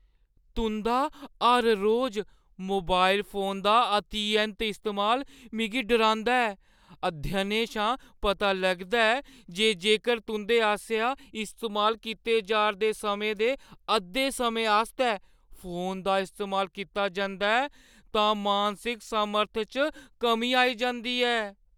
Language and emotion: Dogri, fearful